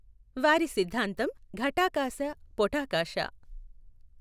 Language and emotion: Telugu, neutral